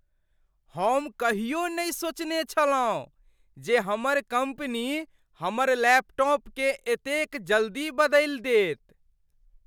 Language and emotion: Maithili, surprised